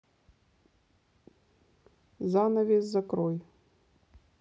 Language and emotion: Russian, neutral